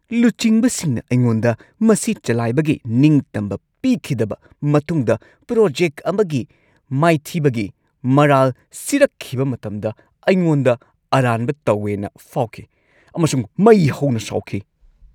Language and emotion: Manipuri, angry